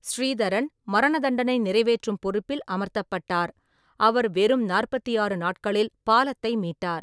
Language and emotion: Tamil, neutral